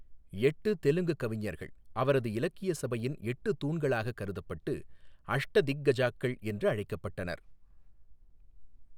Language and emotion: Tamil, neutral